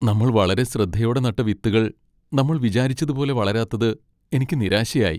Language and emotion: Malayalam, sad